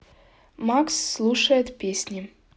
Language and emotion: Russian, neutral